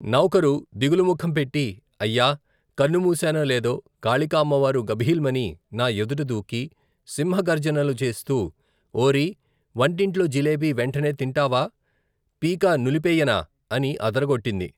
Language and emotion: Telugu, neutral